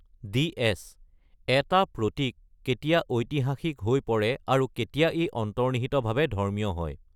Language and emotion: Assamese, neutral